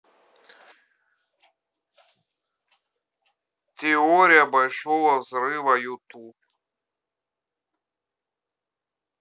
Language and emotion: Russian, neutral